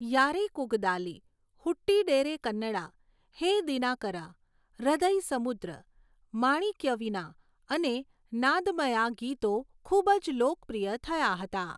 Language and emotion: Gujarati, neutral